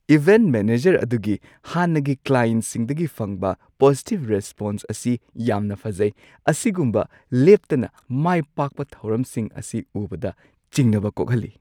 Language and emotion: Manipuri, surprised